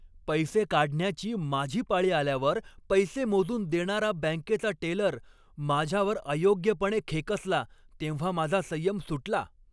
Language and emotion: Marathi, angry